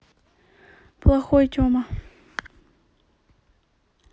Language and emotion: Russian, neutral